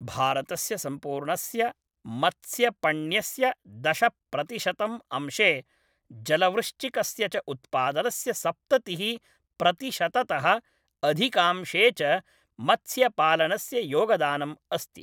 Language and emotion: Sanskrit, neutral